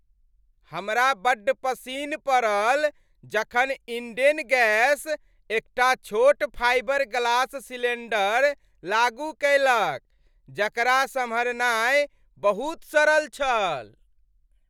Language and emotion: Maithili, happy